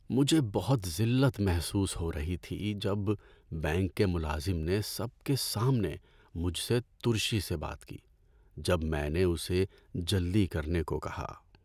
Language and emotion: Urdu, sad